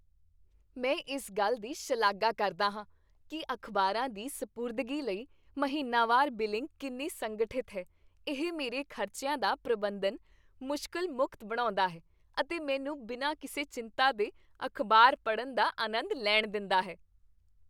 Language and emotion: Punjabi, happy